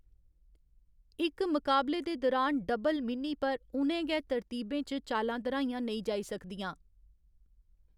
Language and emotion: Dogri, neutral